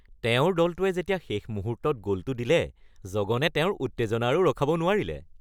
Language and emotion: Assamese, happy